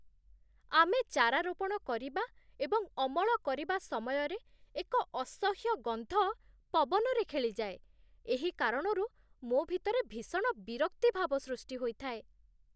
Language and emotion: Odia, disgusted